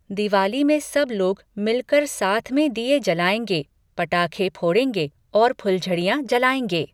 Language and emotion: Hindi, neutral